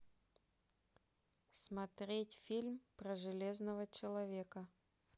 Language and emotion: Russian, neutral